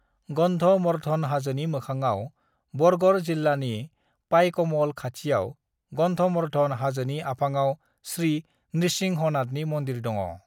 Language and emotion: Bodo, neutral